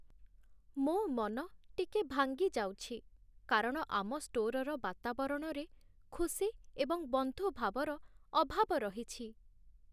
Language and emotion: Odia, sad